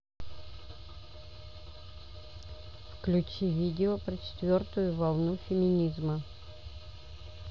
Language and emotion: Russian, neutral